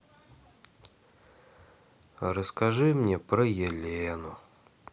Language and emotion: Russian, sad